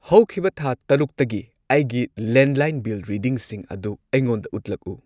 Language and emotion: Manipuri, neutral